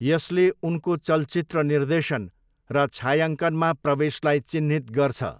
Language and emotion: Nepali, neutral